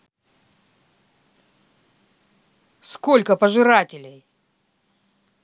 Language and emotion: Russian, angry